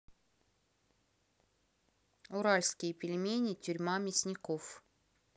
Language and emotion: Russian, neutral